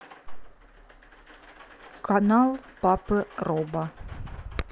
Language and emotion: Russian, neutral